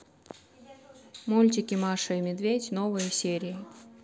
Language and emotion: Russian, neutral